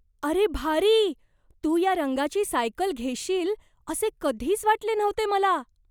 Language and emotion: Marathi, surprised